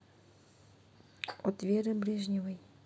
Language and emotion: Russian, neutral